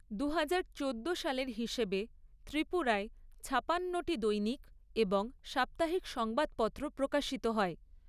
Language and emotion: Bengali, neutral